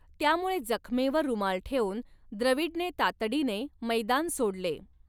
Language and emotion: Marathi, neutral